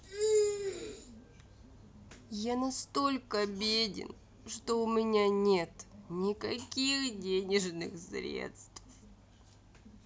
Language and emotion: Russian, sad